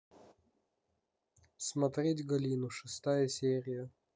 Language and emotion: Russian, neutral